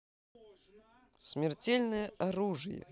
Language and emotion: Russian, positive